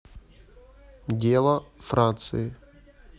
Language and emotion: Russian, neutral